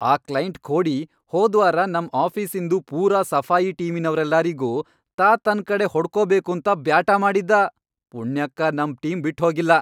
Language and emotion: Kannada, angry